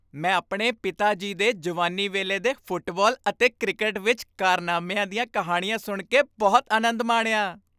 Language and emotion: Punjabi, happy